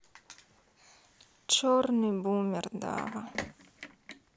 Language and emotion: Russian, sad